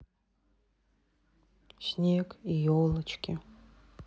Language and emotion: Russian, sad